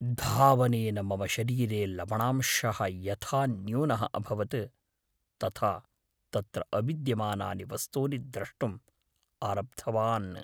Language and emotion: Sanskrit, fearful